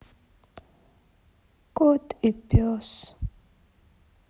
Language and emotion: Russian, sad